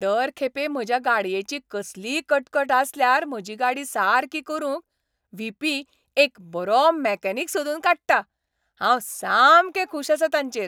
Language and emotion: Goan Konkani, happy